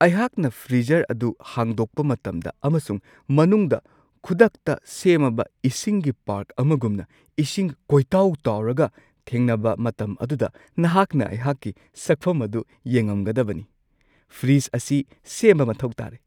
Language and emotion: Manipuri, surprised